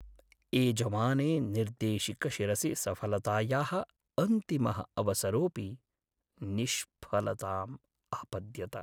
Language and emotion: Sanskrit, sad